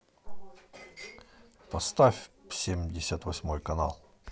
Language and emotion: Russian, neutral